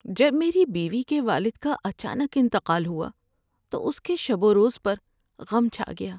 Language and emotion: Urdu, sad